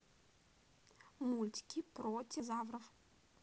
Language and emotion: Russian, neutral